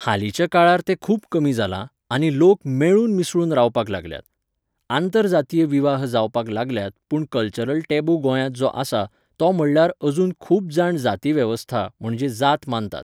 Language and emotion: Goan Konkani, neutral